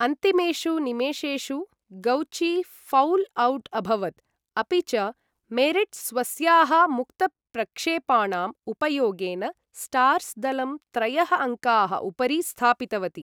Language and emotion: Sanskrit, neutral